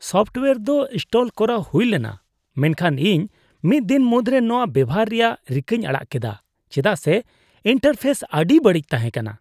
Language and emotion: Santali, disgusted